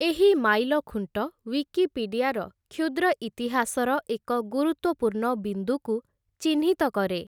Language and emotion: Odia, neutral